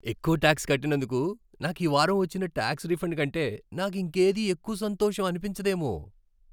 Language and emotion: Telugu, happy